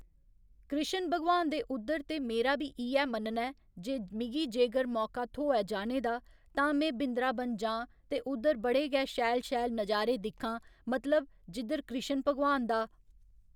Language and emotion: Dogri, neutral